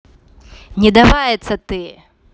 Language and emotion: Russian, angry